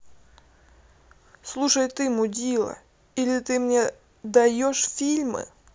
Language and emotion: Russian, angry